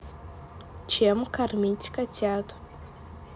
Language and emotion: Russian, neutral